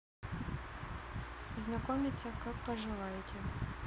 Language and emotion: Russian, neutral